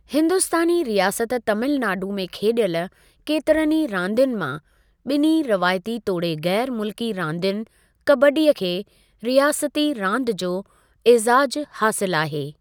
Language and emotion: Sindhi, neutral